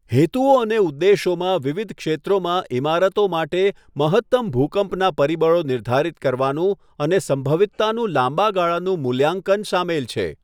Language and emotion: Gujarati, neutral